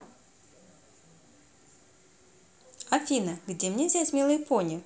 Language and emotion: Russian, positive